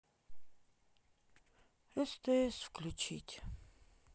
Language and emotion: Russian, sad